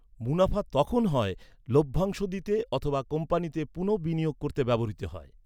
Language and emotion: Bengali, neutral